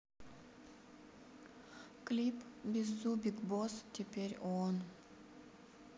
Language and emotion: Russian, sad